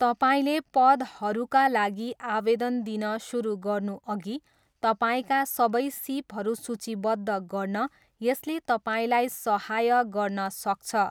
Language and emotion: Nepali, neutral